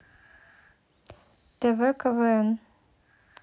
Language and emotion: Russian, neutral